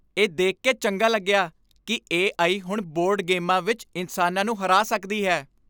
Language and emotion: Punjabi, happy